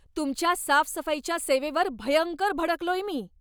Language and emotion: Marathi, angry